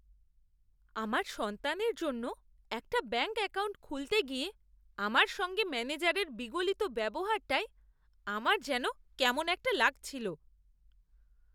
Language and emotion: Bengali, disgusted